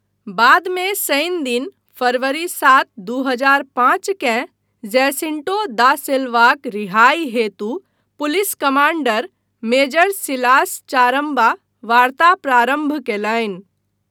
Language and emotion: Maithili, neutral